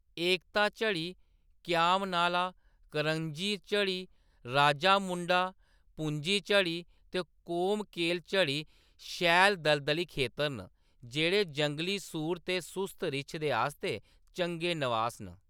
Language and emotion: Dogri, neutral